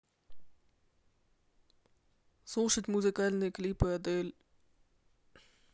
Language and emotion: Russian, neutral